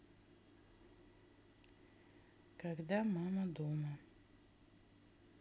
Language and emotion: Russian, sad